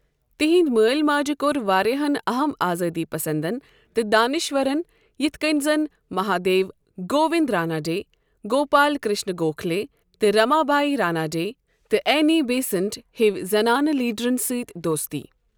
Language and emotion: Kashmiri, neutral